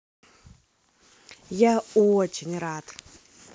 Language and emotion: Russian, positive